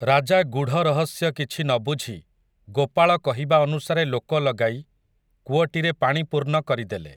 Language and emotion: Odia, neutral